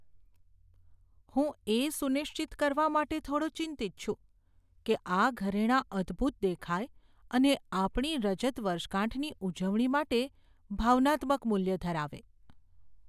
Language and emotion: Gujarati, fearful